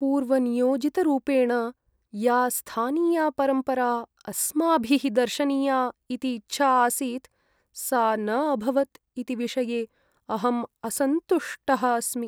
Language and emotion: Sanskrit, sad